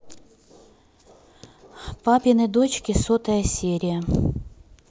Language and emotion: Russian, neutral